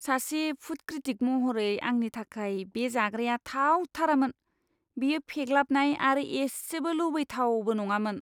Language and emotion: Bodo, disgusted